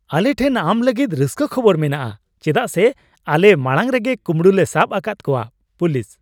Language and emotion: Santali, happy